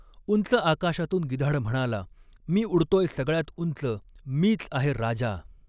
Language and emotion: Marathi, neutral